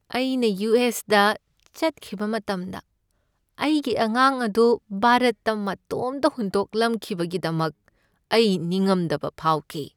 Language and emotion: Manipuri, sad